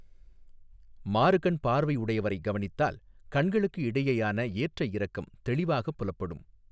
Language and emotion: Tamil, neutral